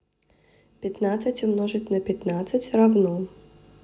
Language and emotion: Russian, neutral